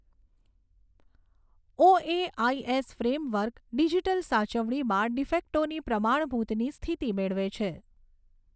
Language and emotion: Gujarati, neutral